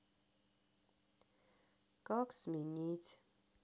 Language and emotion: Russian, sad